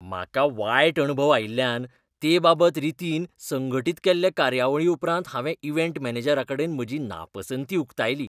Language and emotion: Goan Konkani, disgusted